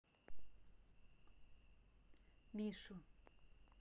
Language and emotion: Russian, neutral